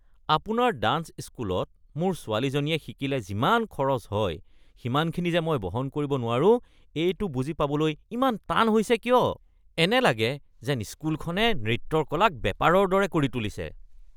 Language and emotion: Assamese, disgusted